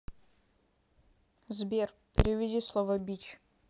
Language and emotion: Russian, neutral